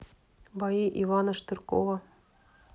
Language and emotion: Russian, neutral